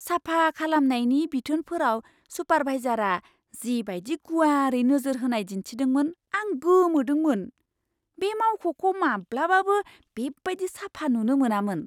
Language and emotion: Bodo, surprised